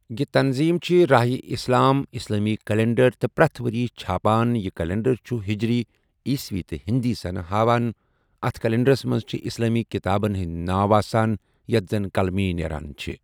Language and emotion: Kashmiri, neutral